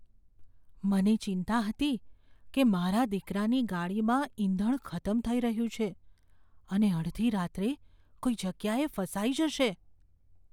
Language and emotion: Gujarati, fearful